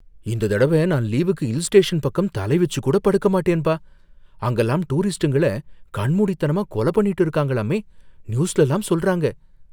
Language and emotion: Tamil, fearful